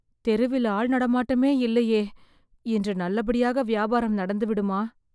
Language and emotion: Tamil, fearful